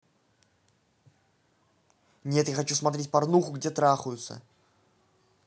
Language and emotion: Russian, angry